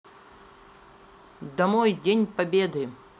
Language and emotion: Russian, positive